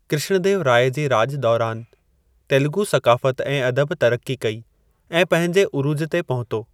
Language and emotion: Sindhi, neutral